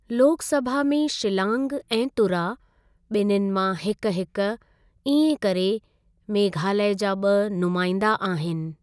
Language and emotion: Sindhi, neutral